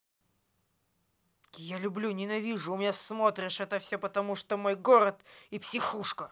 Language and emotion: Russian, angry